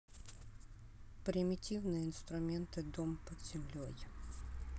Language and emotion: Russian, neutral